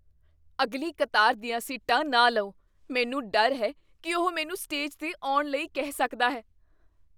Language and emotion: Punjabi, fearful